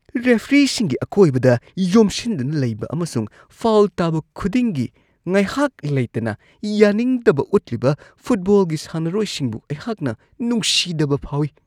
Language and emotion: Manipuri, disgusted